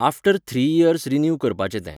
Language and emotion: Goan Konkani, neutral